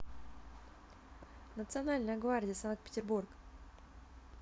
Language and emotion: Russian, neutral